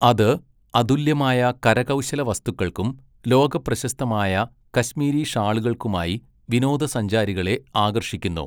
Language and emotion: Malayalam, neutral